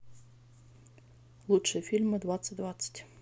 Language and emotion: Russian, neutral